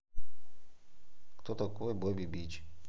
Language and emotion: Russian, neutral